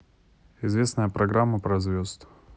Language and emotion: Russian, neutral